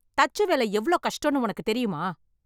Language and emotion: Tamil, angry